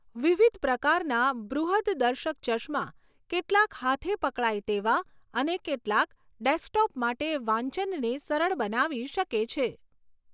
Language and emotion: Gujarati, neutral